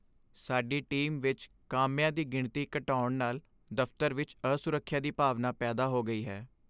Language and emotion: Punjabi, sad